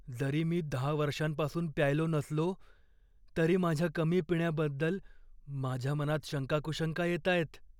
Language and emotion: Marathi, fearful